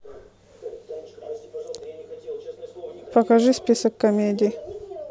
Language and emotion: Russian, neutral